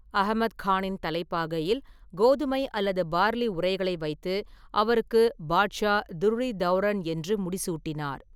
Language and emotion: Tamil, neutral